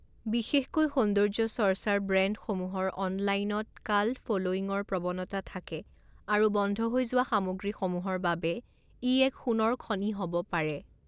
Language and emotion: Assamese, neutral